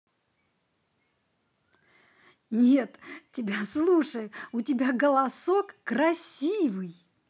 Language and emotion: Russian, positive